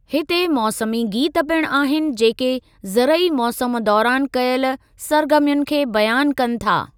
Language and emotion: Sindhi, neutral